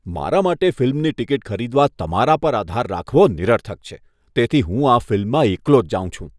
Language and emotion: Gujarati, disgusted